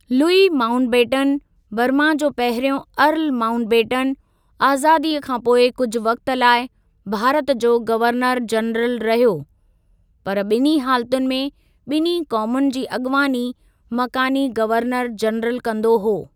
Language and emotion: Sindhi, neutral